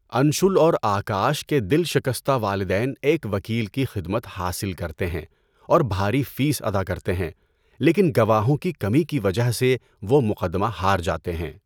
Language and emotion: Urdu, neutral